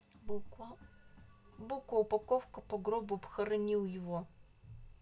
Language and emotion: Russian, neutral